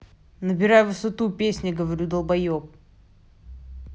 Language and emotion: Russian, angry